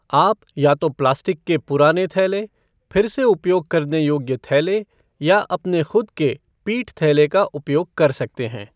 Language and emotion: Hindi, neutral